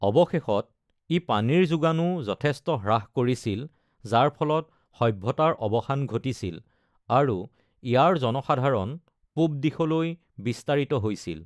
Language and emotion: Assamese, neutral